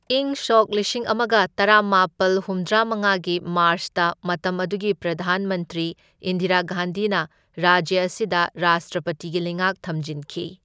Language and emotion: Manipuri, neutral